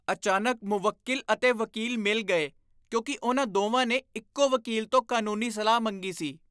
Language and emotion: Punjabi, disgusted